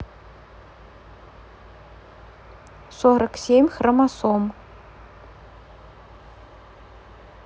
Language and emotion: Russian, neutral